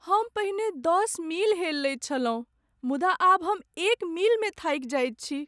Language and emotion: Maithili, sad